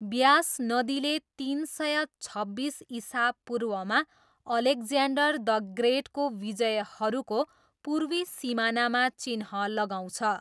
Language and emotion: Nepali, neutral